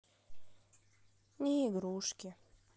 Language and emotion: Russian, sad